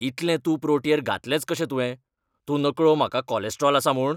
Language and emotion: Goan Konkani, angry